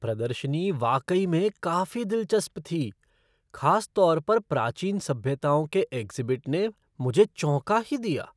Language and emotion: Hindi, surprised